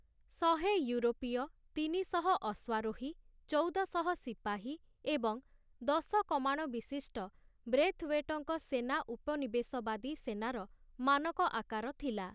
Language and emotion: Odia, neutral